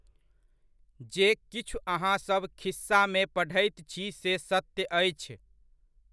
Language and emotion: Maithili, neutral